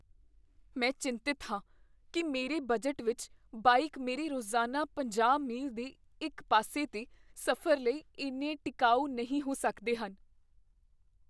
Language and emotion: Punjabi, fearful